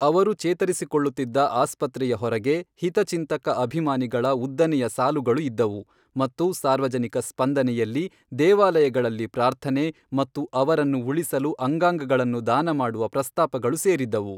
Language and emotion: Kannada, neutral